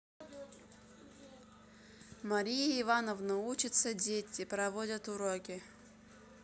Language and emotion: Russian, neutral